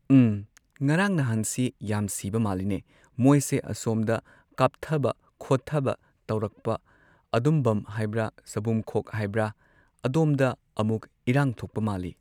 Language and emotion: Manipuri, neutral